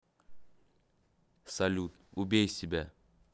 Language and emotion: Russian, neutral